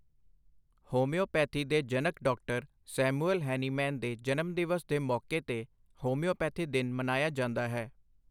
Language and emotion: Punjabi, neutral